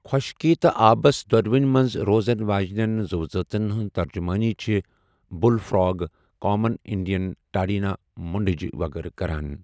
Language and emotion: Kashmiri, neutral